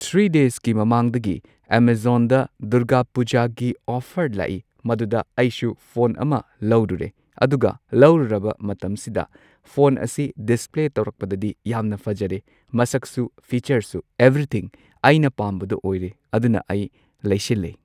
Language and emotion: Manipuri, neutral